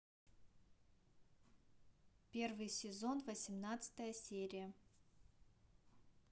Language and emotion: Russian, neutral